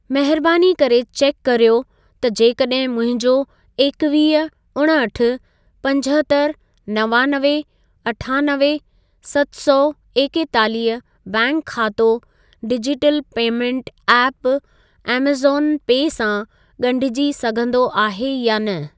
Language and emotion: Sindhi, neutral